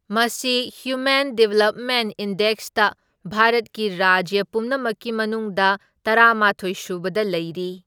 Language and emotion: Manipuri, neutral